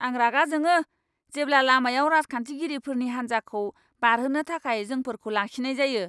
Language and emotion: Bodo, angry